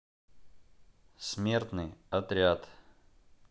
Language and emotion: Russian, neutral